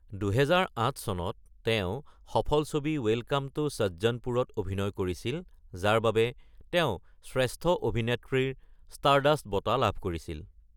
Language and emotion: Assamese, neutral